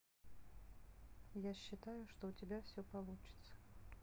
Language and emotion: Russian, neutral